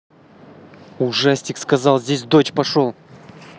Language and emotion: Russian, angry